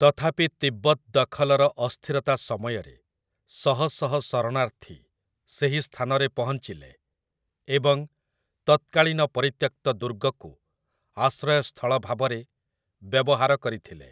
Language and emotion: Odia, neutral